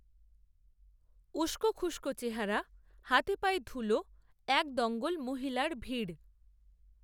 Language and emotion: Bengali, neutral